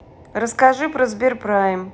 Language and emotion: Russian, neutral